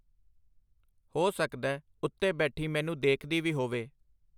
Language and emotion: Punjabi, neutral